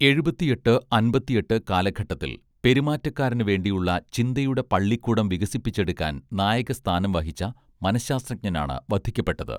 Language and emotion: Malayalam, neutral